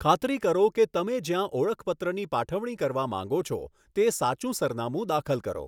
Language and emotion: Gujarati, neutral